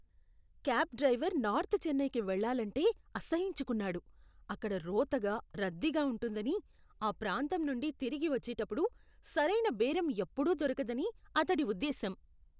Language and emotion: Telugu, disgusted